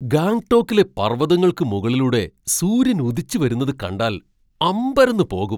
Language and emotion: Malayalam, surprised